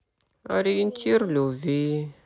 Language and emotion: Russian, sad